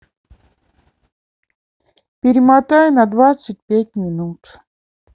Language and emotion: Russian, neutral